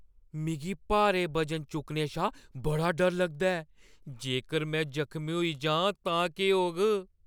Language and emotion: Dogri, fearful